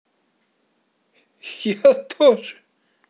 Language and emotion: Russian, positive